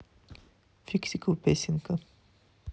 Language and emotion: Russian, neutral